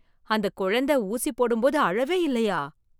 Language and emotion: Tamil, surprised